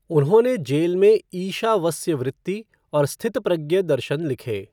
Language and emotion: Hindi, neutral